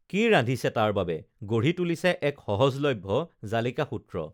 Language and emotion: Assamese, neutral